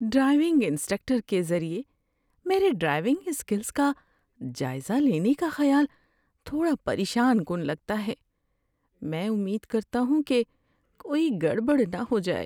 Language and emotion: Urdu, fearful